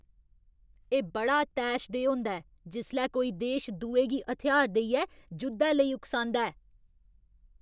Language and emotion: Dogri, angry